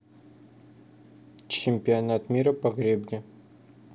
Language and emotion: Russian, neutral